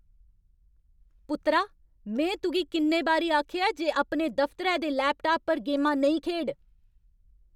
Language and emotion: Dogri, angry